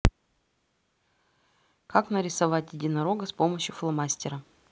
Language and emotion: Russian, neutral